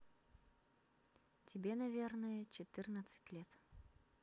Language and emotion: Russian, neutral